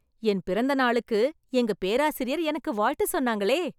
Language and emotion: Tamil, happy